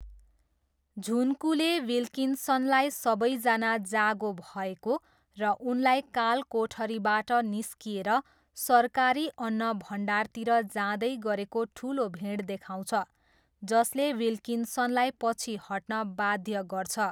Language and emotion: Nepali, neutral